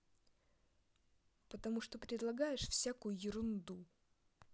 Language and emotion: Russian, angry